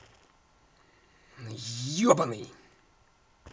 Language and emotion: Russian, angry